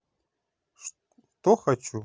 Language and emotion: Russian, neutral